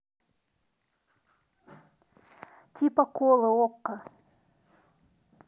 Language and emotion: Russian, neutral